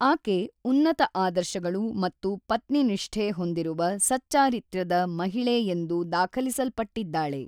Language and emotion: Kannada, neutral